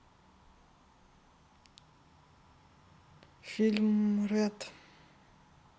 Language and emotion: Russian, neutral